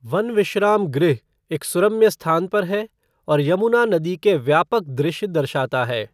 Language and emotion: Hindi, neutral